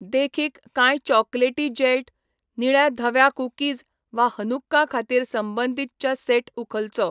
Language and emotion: Goan Konkani, neutral